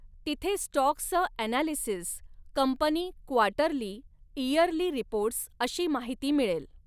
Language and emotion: Marathi, neutral